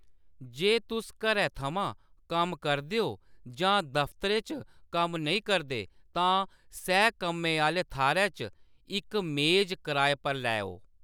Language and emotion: Dogri, neutral